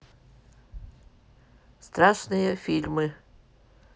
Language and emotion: Russian, neutral